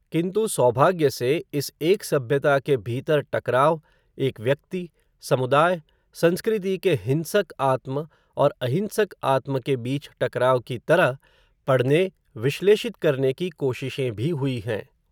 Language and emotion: Hindi, neutral